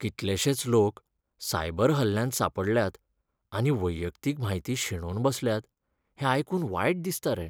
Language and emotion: Goan Konkani, sad